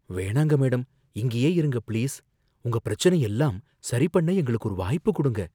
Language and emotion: Tamil, fearful